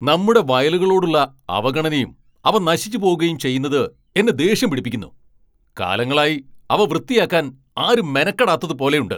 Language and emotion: Malayalam, angry